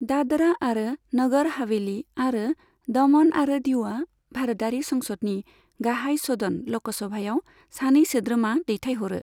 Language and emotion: Bodo, neutral